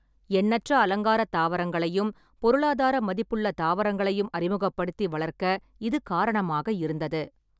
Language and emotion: Tamil, neutral